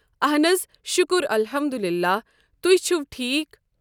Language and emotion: Kashmiri, neutral